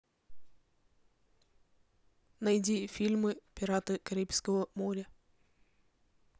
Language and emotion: Russian, neutral